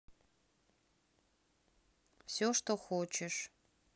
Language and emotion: Russian, neutral